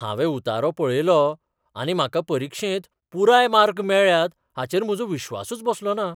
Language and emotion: Goan Konkani, surprised